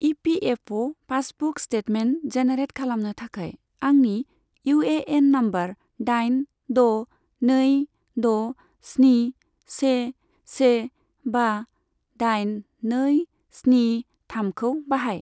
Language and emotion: Bodo, neutral